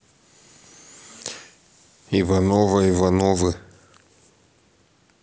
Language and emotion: Russian, neutral